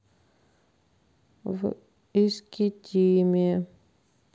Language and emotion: Russian, sad